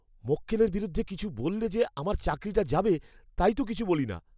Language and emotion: Bengali, fearful